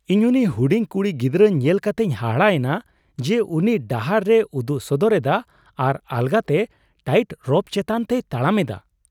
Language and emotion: Santali, surprised